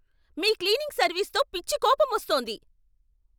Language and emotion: Telugu, angry